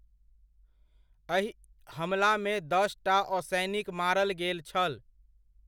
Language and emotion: Maithili, neutral